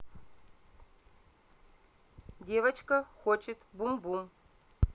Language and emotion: Russian, neutral